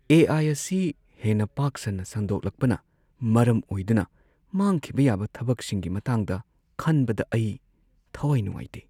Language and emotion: Manipuri, sad